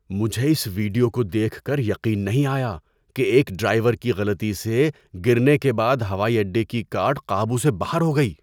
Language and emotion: Urdu, surprised